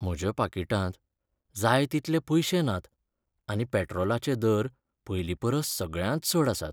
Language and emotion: Goan Konkani, sad